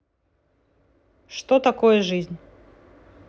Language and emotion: Russian, neutral